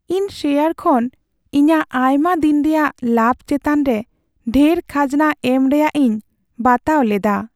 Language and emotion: Santali, sad